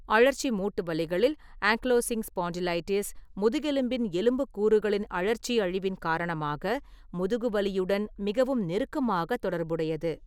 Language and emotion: Tamil, neutral